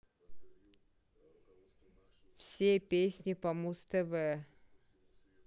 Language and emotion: Russian, neutral